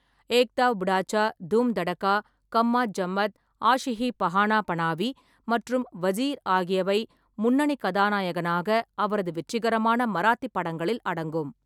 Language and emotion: Tamil, neutral